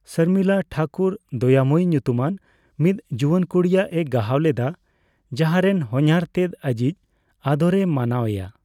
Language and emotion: Santali, neutral